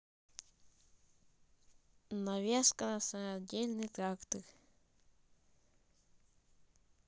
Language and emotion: Russian, neutral